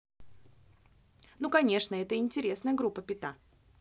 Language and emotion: Russian, positive